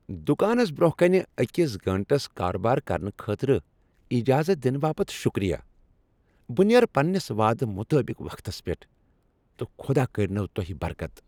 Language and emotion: Kashmiri, happy